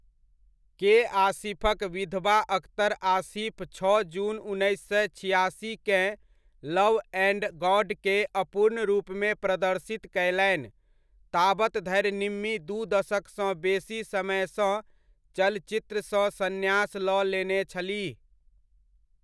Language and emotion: Maithili, neutral